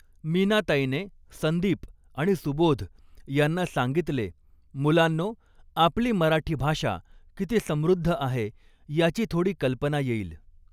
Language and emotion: Marathi, neutral